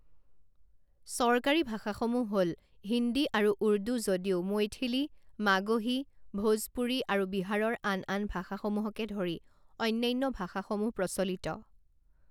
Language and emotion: Assamese, neutral